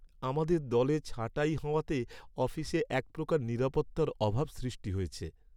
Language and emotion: Bengali, sad